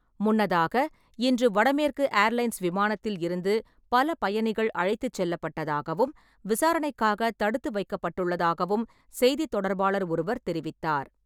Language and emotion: Tamil, neutral